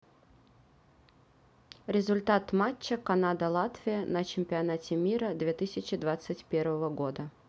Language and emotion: Russian, neutral